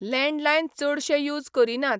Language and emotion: Goan Konkani, neutral